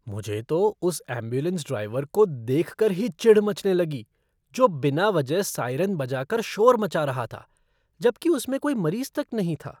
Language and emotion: Hindi, disgusted